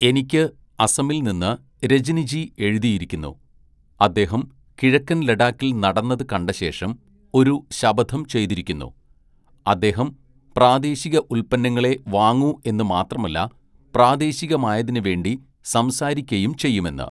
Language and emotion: Malayalam, neutral